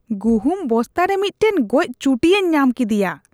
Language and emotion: Santali, disgusted